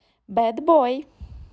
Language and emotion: Russian, positive